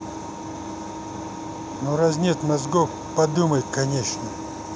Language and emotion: Russian, angry